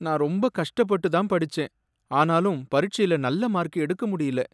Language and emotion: Tamil, sad